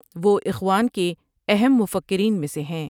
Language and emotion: Urdu, neutral